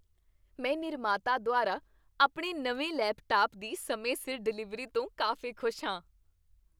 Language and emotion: Punjabi, happy